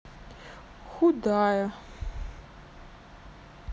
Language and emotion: Russian, sad